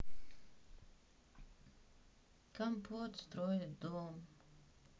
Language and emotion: Russian, sad